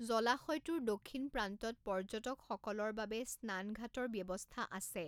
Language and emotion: Assamese, neutral